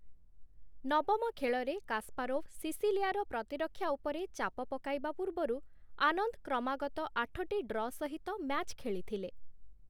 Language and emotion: Odia, neutral